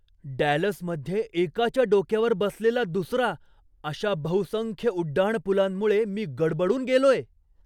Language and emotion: Marathi, surprised